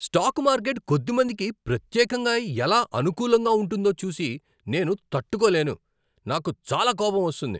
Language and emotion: Telugu, angry